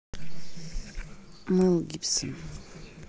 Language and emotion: Russian, neutral